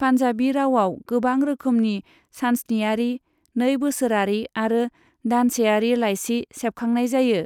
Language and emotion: Bodo, neutral